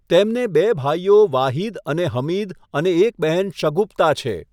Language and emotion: Gujarati, neutral